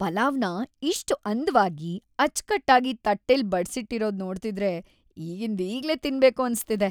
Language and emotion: Kannada, happy